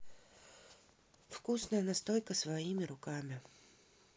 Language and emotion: Russian, neutral